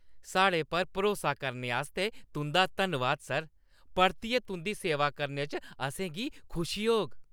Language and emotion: Dogri, happy